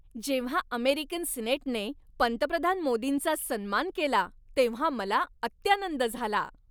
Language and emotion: Marathi, happy